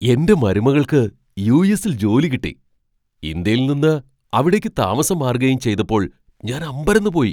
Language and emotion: Malayalam, surprised